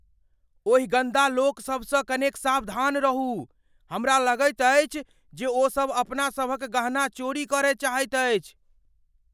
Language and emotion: Maithili, fearful